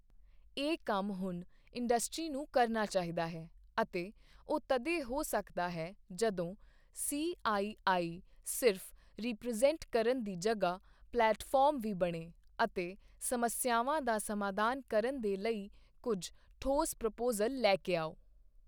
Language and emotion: Punjabi, neutral